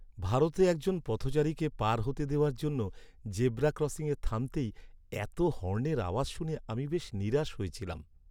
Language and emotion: Bengali, sad